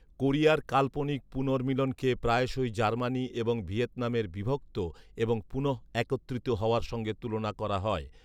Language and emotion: Bengali, neutral